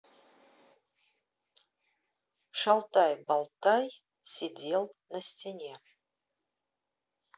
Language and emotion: Russian, neutral